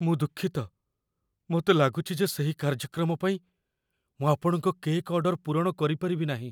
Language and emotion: Odia, fearful